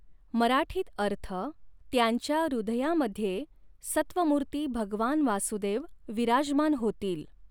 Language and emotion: Marathi, neutral